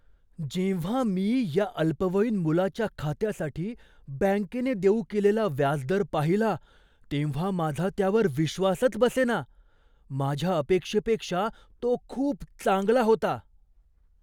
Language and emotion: Marathi, surprised